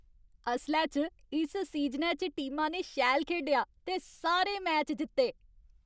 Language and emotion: Dogri, happy